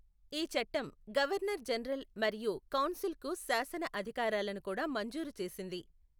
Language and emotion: Telugu, neutral